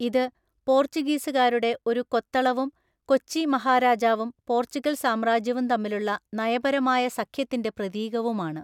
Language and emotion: Malayalam, neutral